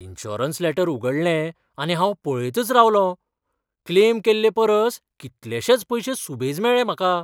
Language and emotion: Goan Konkani, surprised